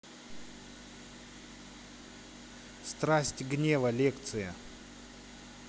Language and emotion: Russian, neutral